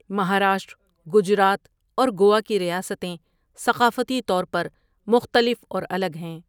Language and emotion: Urdu, neutral